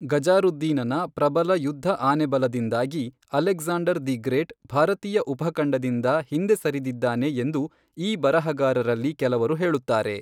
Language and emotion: Kannada, neutral